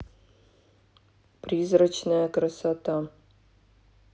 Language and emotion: Russian, neutral